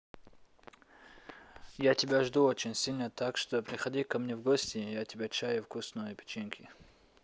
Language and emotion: Russian, neutral